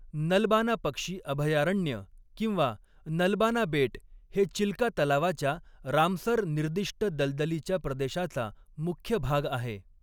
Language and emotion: Marathi, neutral